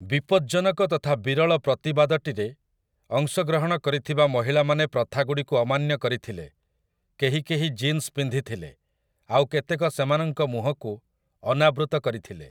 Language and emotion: Odia, neutral